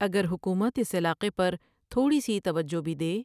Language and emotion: Urdu, neutral